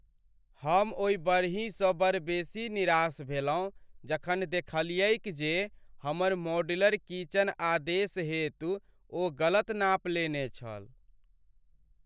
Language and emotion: Maithili, sad